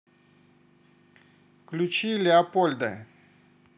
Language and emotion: Russian, neutral